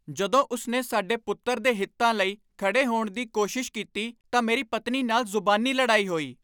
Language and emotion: Punjabi, angry